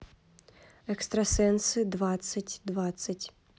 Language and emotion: Russian, neutral